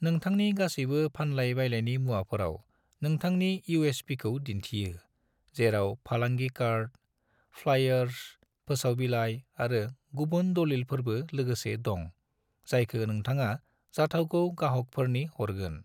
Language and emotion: Bodo, neutral